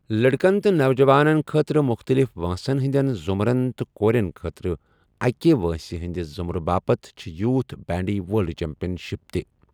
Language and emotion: Kashmiri, neutral